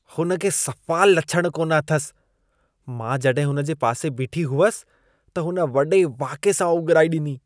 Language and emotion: Sindhi, disgusted